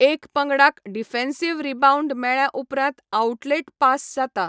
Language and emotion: Goan Konkani, neutral